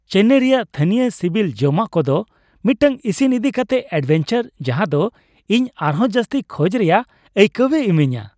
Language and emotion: Santali, happy